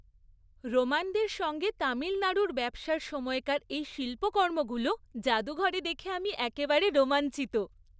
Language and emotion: Bengali, happy